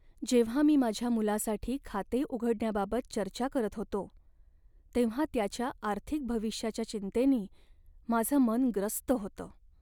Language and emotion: Marathi, sad